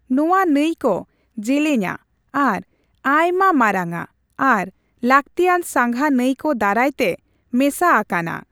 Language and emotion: Santali, neutral